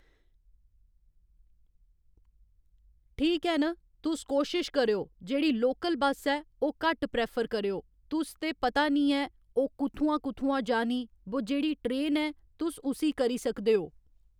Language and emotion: Dogri, neutral